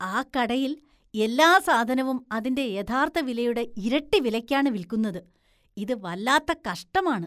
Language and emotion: Malayalam, disgusted